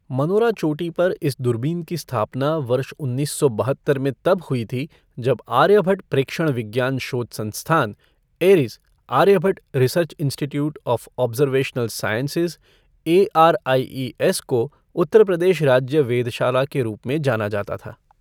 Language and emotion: Hindi, neutral